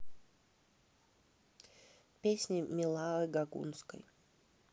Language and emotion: Russian, neutral